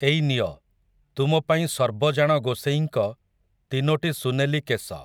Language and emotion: Odia, neutral